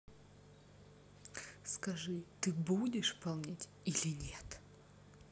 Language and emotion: Russian, angry